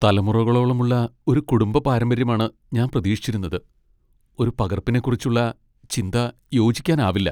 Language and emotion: Malayalam, sad